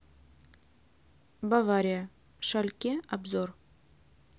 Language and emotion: Russian, neutral